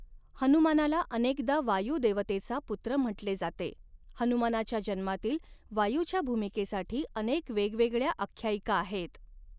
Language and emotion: Marathi, neutral